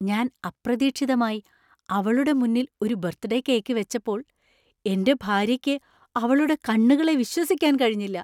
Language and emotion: Malayalam, surprised